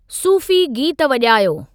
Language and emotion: Sindhi, neutral